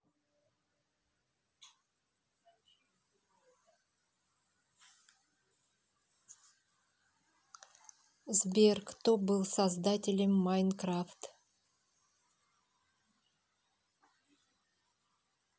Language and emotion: Russian, neutral